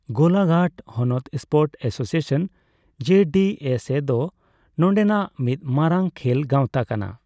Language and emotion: Santali, neutral